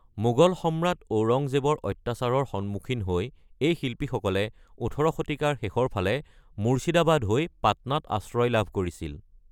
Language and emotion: Assamese, neutral